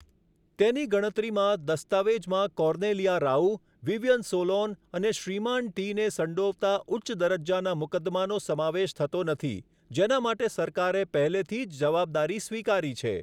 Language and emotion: Gujarati, neutral